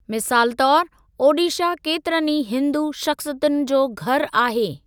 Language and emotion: Sindhi, neutral